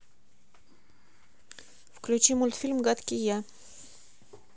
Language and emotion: Russian, neutral